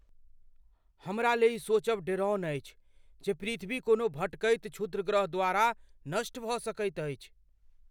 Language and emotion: Maithili, fearful